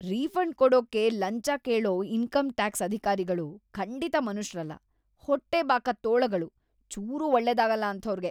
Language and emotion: Kannada, disgusted